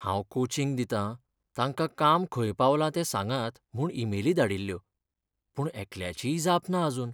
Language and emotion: Goan Konkani, sad